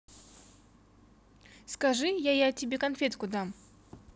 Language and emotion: Russian, neutral